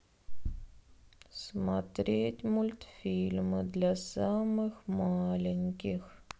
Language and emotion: Russian, sad